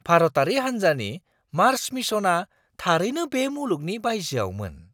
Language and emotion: Bodo, surprised